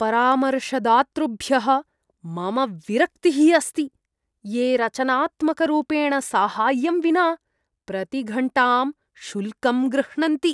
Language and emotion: Sanskrit, disgusted